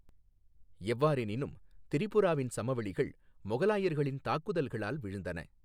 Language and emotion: Tamil, neutral